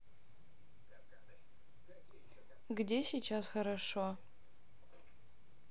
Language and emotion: Russian, sad